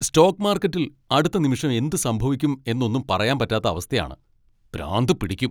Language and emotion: Malayalam, angry